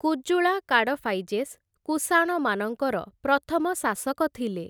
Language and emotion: Odia, neutral